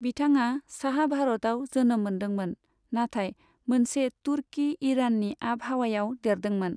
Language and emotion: Bodo, neutral